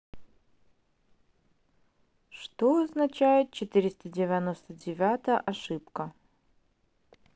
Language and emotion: Russian, neutral